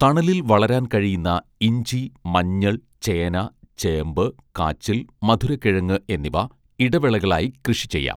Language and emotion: Malayalam, neutral